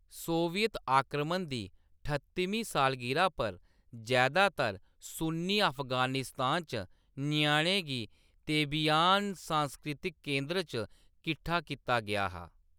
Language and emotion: Dogri, neutral